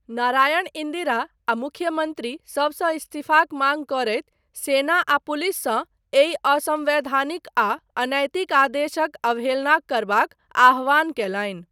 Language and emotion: Maithili, neutral